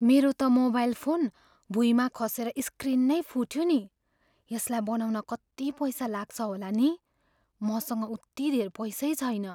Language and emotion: Nepali, fearful